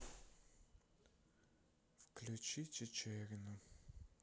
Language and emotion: Russian, sad